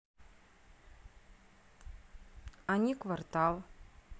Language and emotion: Russian, neutral